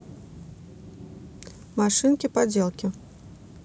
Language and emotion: Russian, neutral